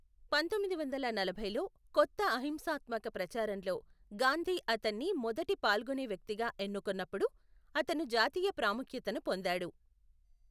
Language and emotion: Telugu, neutral